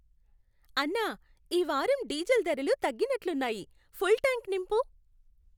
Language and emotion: Telugu, happy